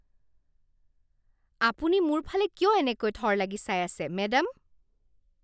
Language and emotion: Assamese, disgusted